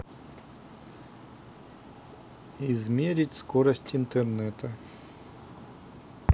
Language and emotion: Russian, neutral